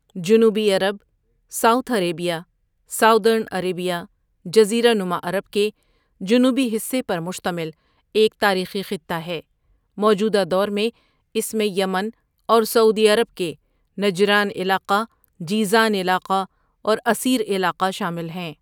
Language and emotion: Urdu, neutral